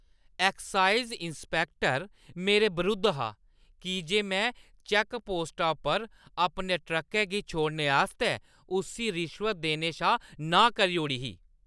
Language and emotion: Dogri, angry